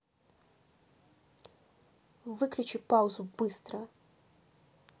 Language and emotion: Russian, angry